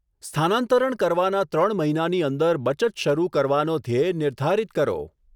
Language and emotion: Gujarati, neutral